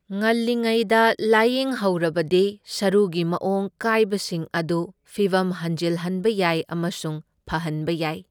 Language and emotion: Manipuri, neutral